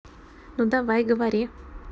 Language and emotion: Russian, neutral